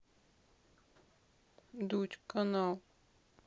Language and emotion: Russian, sad